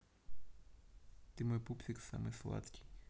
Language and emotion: Russian, neutral